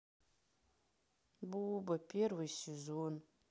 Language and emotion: Russian, sad